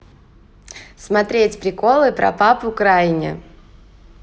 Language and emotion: Russian, positive